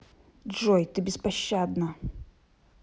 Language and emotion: Russian, angry